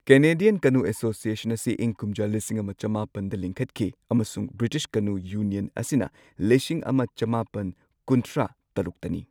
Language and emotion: Manipuri, neutral